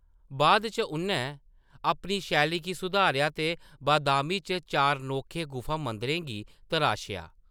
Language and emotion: Dogri, neutral